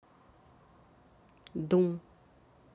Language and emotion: Russian, neutral